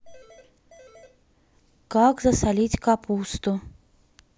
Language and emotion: Russian, neutral